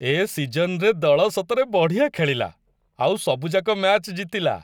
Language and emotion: Odia, happy